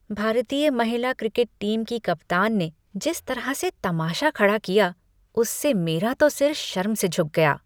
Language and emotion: Hindi, disgusted